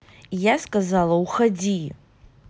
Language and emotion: Russian, angry